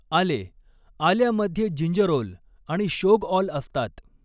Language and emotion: Marathi, neutral